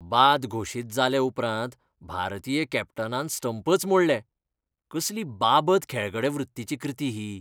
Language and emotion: Goan Konkani, disgusted